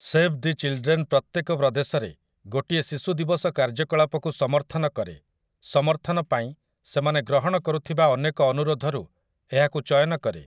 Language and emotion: Odia, neutral